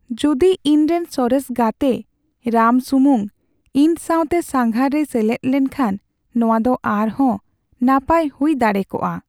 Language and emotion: Santali, sad